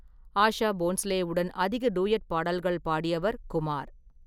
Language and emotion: Tamil, neutral